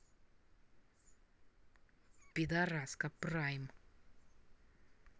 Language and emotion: Russian, angry